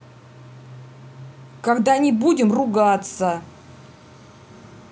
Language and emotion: Russian, angry